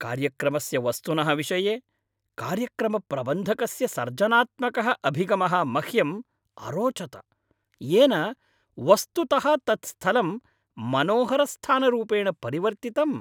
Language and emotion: Sanskrit, happy